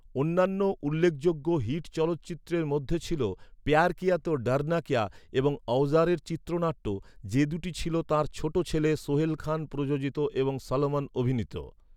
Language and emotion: Bengali, neutral